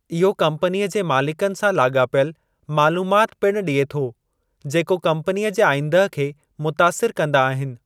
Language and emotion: Sindhi, neutral